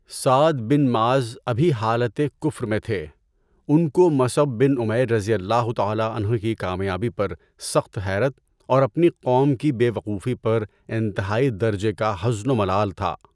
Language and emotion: Urdu, neutral